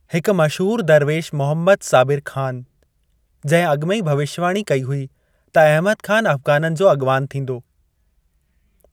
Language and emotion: Sindhi, neutral